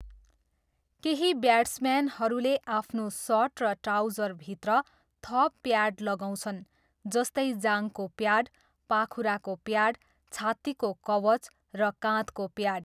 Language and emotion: Nepali, neutral